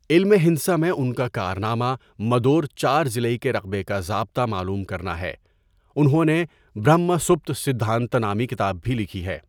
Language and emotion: Urdu, neutral